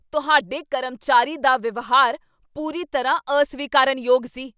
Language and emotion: Punjabi, angry